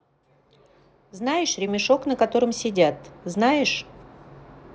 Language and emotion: Russian, neutral